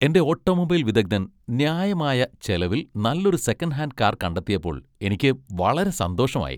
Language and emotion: Malayalam, happy